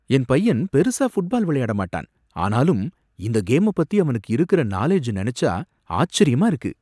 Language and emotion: Tamil, surprised